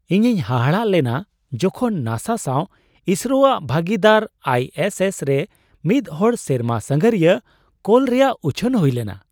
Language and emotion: Santali, surprised